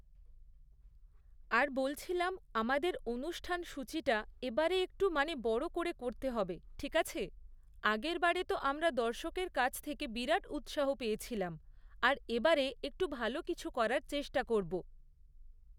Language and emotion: Bengali, neutral